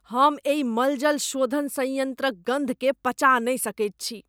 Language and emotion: Maithili, disgusted